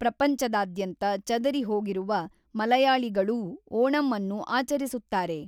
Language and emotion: Kannada, neutral